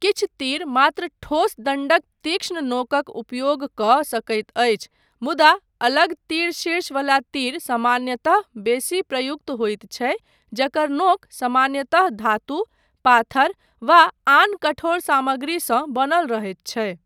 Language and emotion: Maithili, neutral